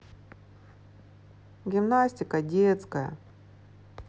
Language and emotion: Russian, sad